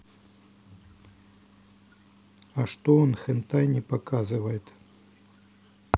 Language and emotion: Russian, neutral